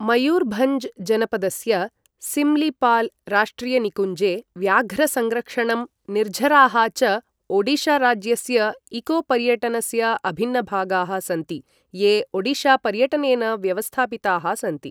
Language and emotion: Sanskrit, neutral